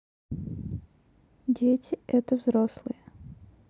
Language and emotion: Russian, neutral